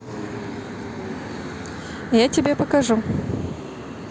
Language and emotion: Russian, neutral